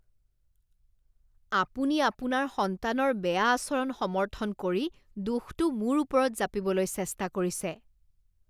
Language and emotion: Assamese, disgusted